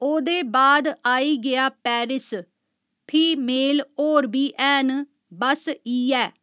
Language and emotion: Dogri, neutral